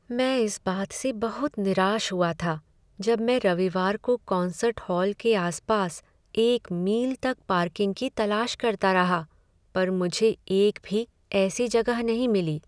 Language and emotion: Hindi, sad